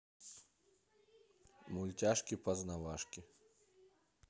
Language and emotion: Russian, neutral